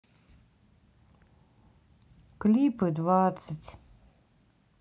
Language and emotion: Russian, sad